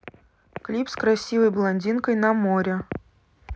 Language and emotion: Russian, neutral